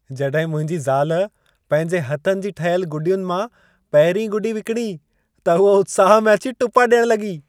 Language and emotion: Sindhi, happy